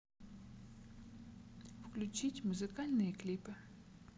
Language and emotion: Russian, neutral